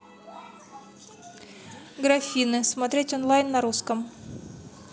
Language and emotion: Russian, neutral